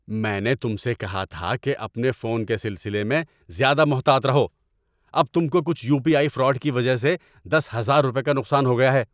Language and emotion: Urdu, angry